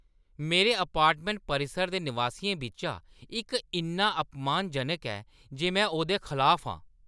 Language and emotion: Dogri, angry